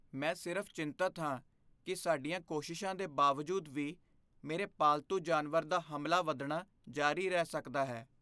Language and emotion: Punjabi, fearful